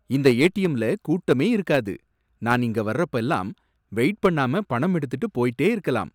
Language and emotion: Tamil, surprised